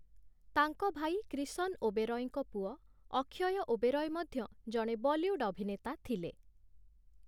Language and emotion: Odia, neutral